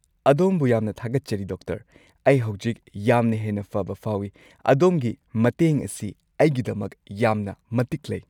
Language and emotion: Manipuri, happy